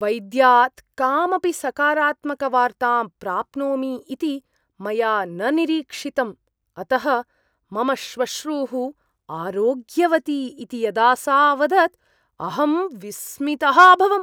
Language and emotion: Sanskrit, surprised